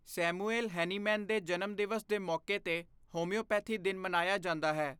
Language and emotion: Punjabi, neutral